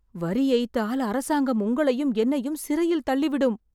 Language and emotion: Tamil, fearful